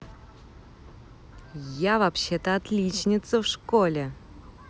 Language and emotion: Russian, positive